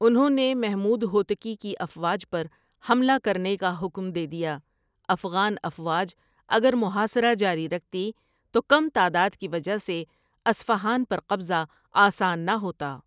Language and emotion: Urdu, neutral